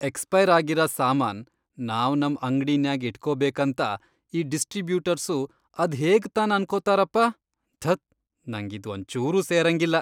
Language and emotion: Kannada, disgusted